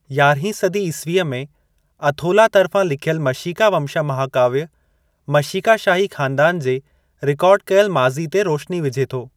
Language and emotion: Sindhi, neutral